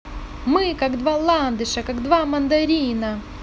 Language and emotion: Russian, positive